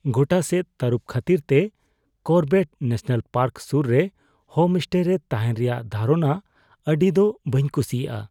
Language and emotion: Santali, fearful